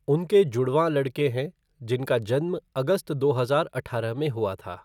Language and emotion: Hindi, neutral